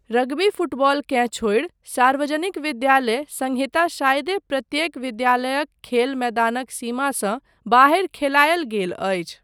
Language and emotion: Maithili, neutral